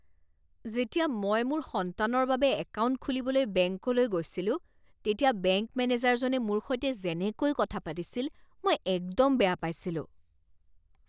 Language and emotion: Assamese, disgusted